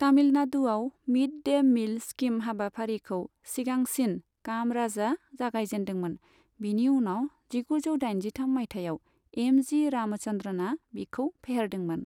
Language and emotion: Bodo, neutral